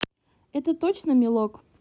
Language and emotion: Russian, neutral